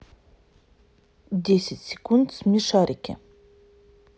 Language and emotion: Russian, neutral